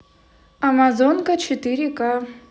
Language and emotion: Russian, neutral